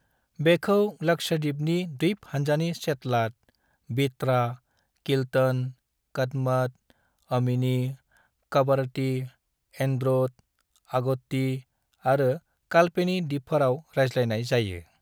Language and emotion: Bodo, neutral